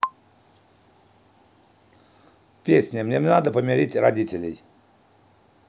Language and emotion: Russian, neutral